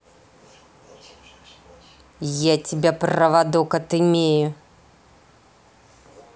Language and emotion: Russian, angry